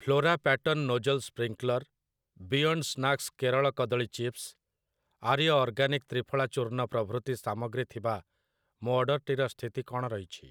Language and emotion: Odia, neutral